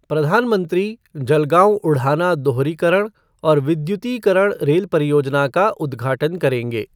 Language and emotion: Hindi, neutral